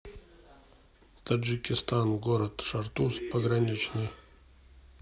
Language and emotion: Russian, neutral